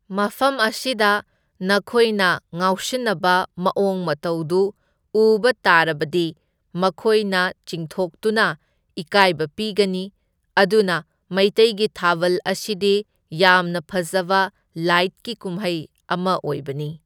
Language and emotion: Manipuri, neutral